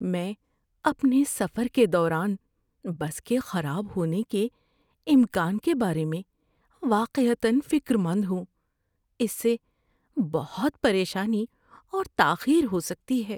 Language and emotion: Urdu, fearful